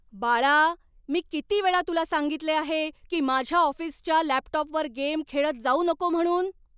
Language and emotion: Marathi, angry